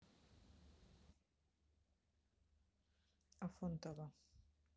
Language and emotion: Russian, neutral